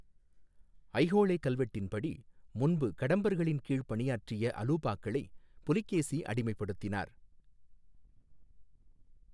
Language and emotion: Tamil, neutral